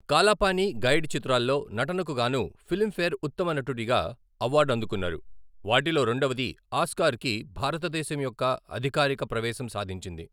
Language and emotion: Telugu, neutral